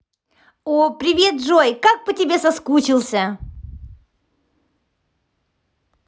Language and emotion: Russian, positive